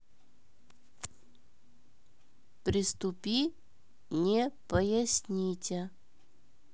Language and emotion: Russian, neutral